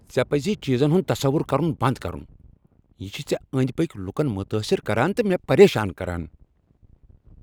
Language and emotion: Kashmiri, angry